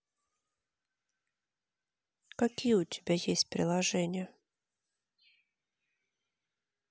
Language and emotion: Russian, neutral